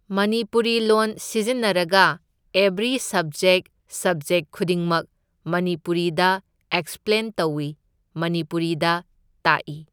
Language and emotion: Manipuri, neutral